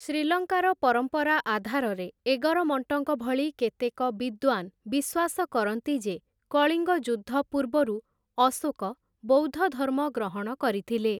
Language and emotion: Odia, neutral